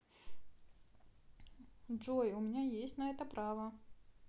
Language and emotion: Russian, neutral